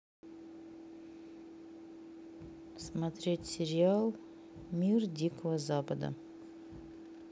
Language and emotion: Russian, neutral